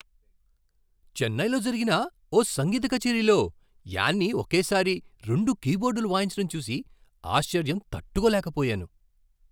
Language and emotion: Telugu, surprised